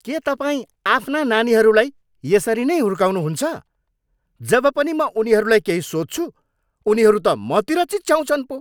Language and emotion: Nepali, angry